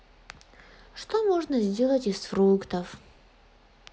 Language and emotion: Russian, sad